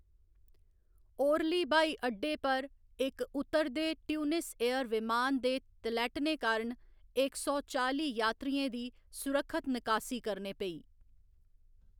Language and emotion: Dogri, neutral